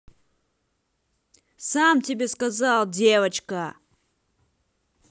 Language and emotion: Russian, angry